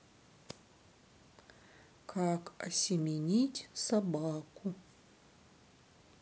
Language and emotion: Russian, sad